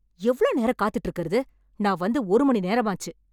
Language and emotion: Tamil, angry